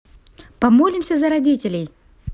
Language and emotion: Russian, positive